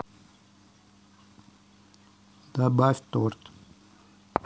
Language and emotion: Russian, neutral